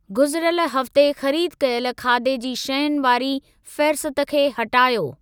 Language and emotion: Sindhi, neutral